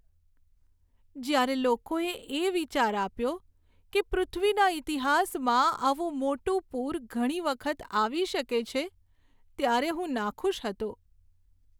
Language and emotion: Gujarati, sad